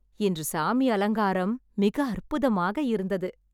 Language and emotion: Tamil, happy